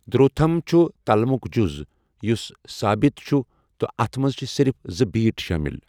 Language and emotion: Kashmiri, neutral